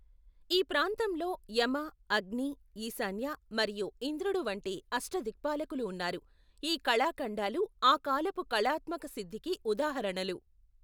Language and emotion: Telugu, neutral